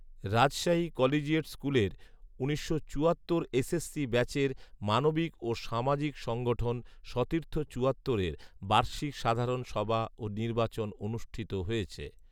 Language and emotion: Bengali, neutral